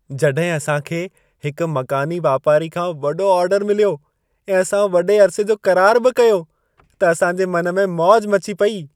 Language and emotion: Sindhi, happy